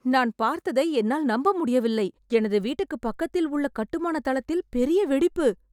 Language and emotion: Tamil, surprised